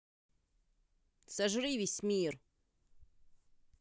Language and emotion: Russian, angry